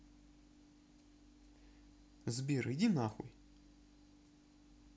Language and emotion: Russian, neutral